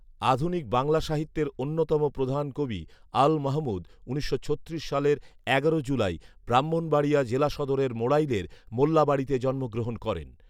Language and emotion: Bengali, neutral